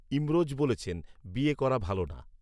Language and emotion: Bengali, neutral